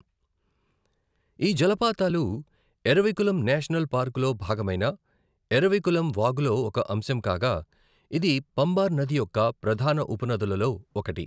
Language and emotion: Telugu, neutral